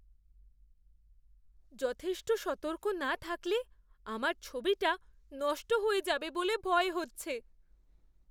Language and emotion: Bengali, fearful